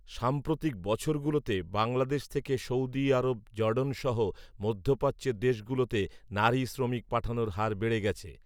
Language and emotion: Bengali, neutral